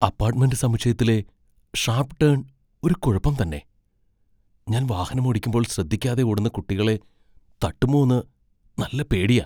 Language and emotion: Malayalam, fearful